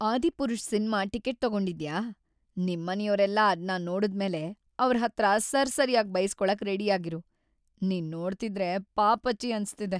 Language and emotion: Kannada, sad